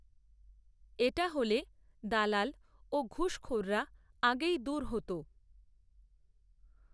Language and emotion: Bengali, neutral